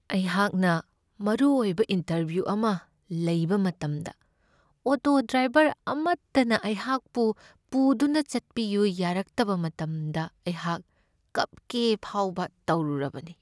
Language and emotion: Manipuri, sad